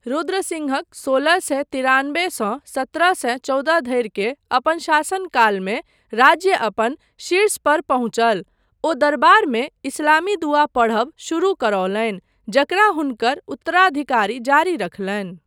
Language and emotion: Maithili, neutral